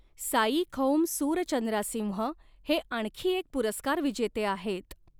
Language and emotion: Marathi, neutral